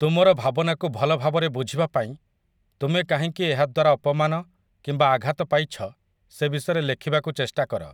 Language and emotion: Odia, neutral